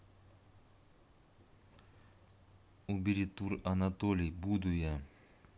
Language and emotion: Russian, neutral